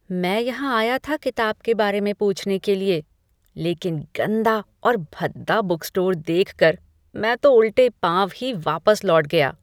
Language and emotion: Hindi, disgusted